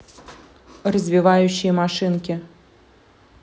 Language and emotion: Russian, neutral